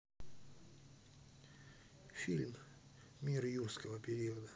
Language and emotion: Russian, neutral